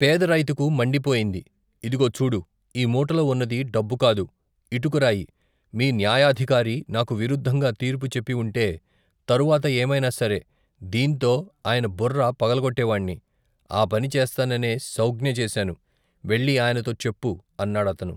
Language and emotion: Telugu, neutral